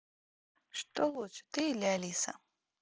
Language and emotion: Russian, neutral